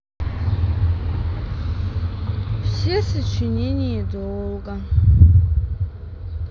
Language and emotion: Russian, sad